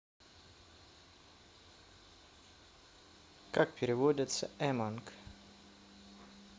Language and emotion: Russian, neutral